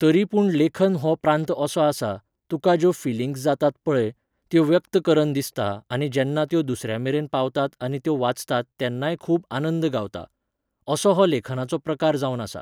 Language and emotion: Goan Konkani, neutral